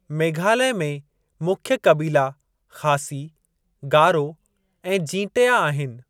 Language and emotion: Sindhi, neutral